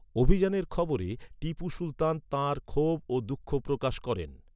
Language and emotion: Bengali, neutral